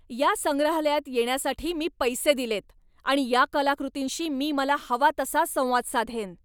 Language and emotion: Marathi, angry